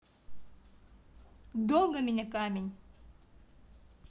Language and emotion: Russian, neutral